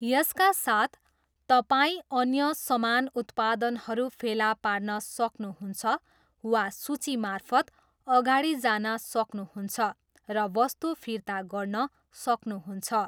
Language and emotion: Nepali, neutral